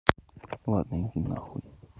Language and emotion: Russian, neutral